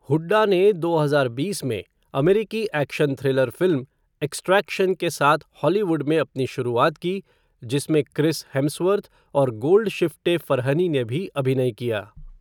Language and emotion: Hindi, neutral